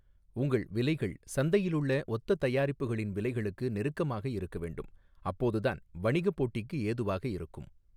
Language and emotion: Tamil, neutral